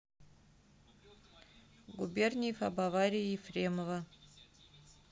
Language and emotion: Russian, neutral